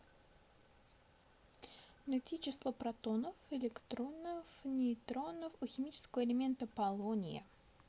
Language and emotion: Russian, neutral